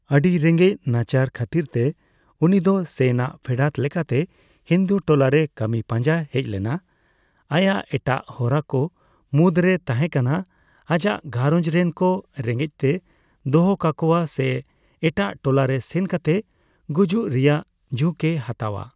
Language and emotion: Santali, neutral